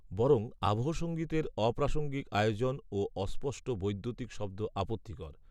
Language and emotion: Bengali, neutral